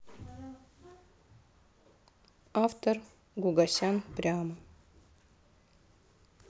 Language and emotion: Russian, neutral